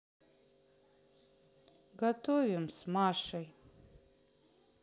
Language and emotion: Russian, sad